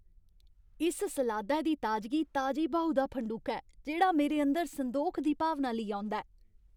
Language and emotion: Dogri, happy